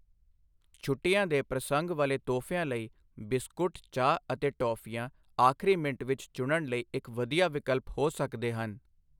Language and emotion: Punjabi, neutral